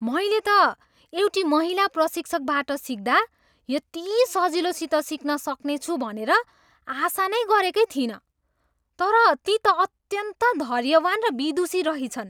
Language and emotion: Nepali, surprised